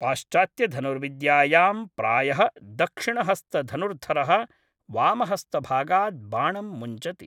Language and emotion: Sanskrit, neutral